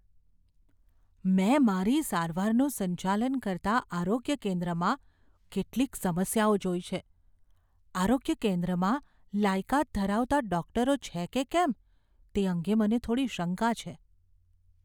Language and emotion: Gujarati, fearful